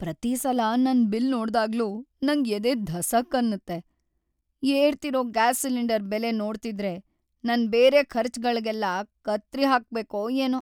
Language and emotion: Kannada, sad